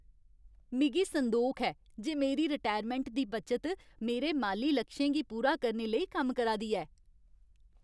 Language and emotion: Dogri, happy